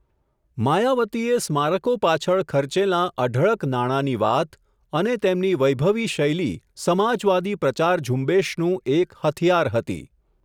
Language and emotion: Gujarati, neutral